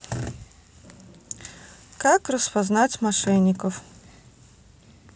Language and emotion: Russian, neutral